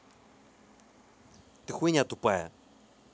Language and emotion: Russian, angry